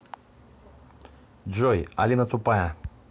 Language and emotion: Russian, neutral